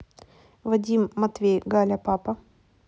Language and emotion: Russian, neutral